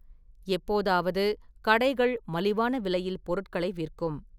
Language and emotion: Tamil, neutral